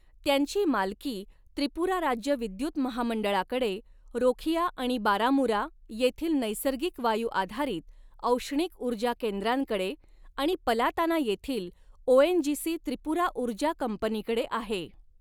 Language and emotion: Marathi, neutral